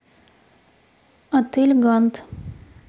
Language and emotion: Russian, neutral